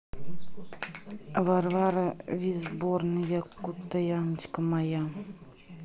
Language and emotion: Russian, neutral